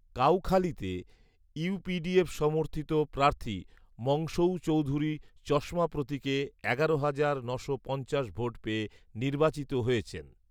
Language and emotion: Bengali, neutral